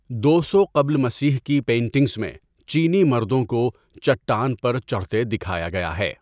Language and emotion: Urdu, neutral